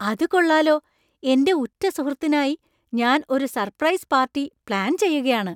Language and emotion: Malayalam, surprised